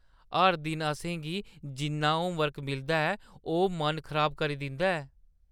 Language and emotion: Dogri, disgusted